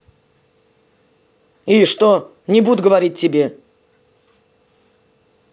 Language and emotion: Russian, angry